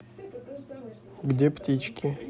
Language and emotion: Russian, neutral